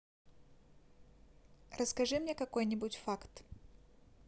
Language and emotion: Russian, neutral